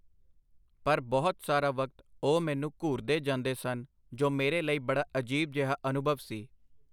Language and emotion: Punjabi, neutral